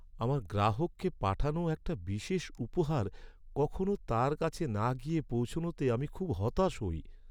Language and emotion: Bengali, sad